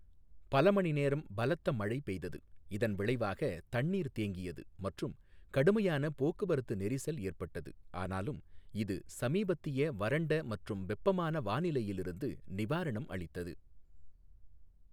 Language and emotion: Tamil, neutral